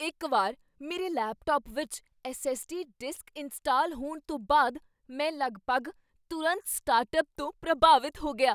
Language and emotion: Punjabi, surprised